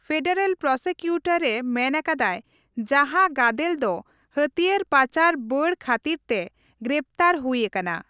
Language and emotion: Santali, neutral